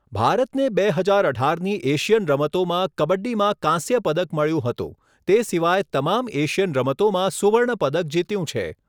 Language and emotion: Gujarati, neutral